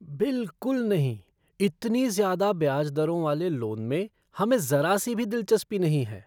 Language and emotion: Hindi, disgusted